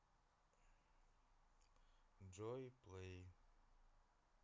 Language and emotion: Russian, neutral